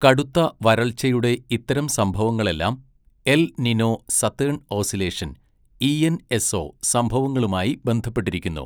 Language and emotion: Malayalam, neutral